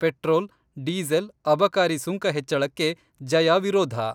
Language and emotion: Kannada, neutral